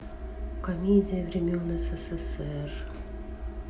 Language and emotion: Russian, sad